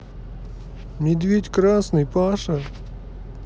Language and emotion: Russian, neutral